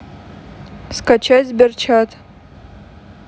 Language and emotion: Russian, neutral